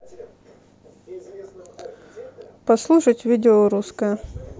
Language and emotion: Russian, neutral